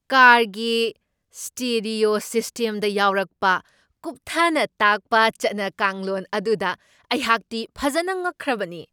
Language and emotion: Manipuri, surprised